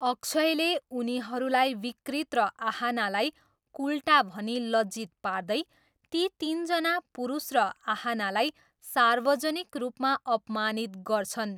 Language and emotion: Nepali, neutral